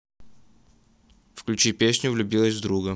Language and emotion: Russian, neutral